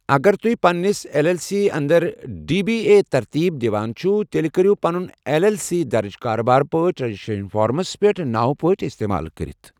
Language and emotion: Kashmiri, neutral